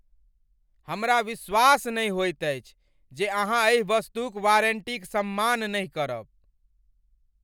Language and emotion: Maithili, angry